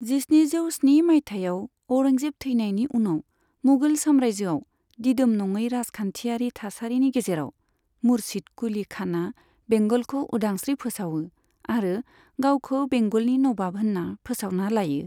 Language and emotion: Bodo, neutral